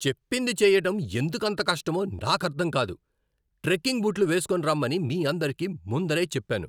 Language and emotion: Telugu, angry